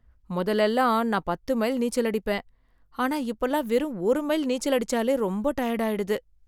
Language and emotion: Tamil, sad